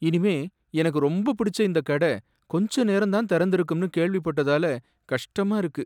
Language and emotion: Tamil, sad